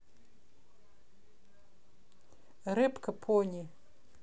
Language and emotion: Russian, neutral